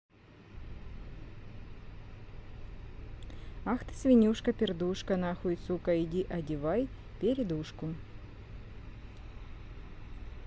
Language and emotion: Russian, neutral